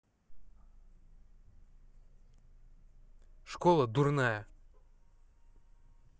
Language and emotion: Russian, angry